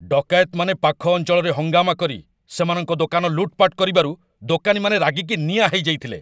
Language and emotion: Odia, angry